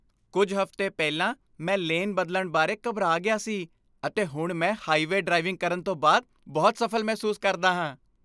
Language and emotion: Punjabi, happy